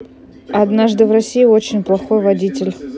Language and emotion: Russian, neutral